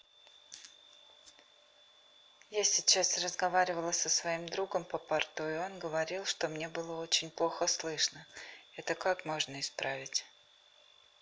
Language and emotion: Russian, neutral